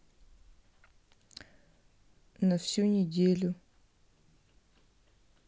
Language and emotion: Russian, sad